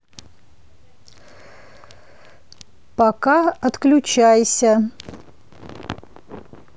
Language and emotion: Russian, neutral